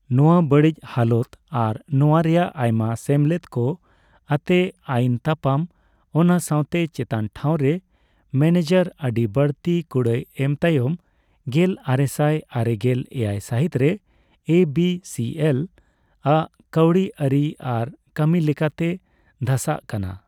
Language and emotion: Santali, neutral